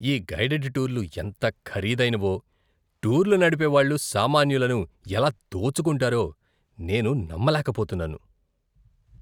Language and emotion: Telugu, disgusted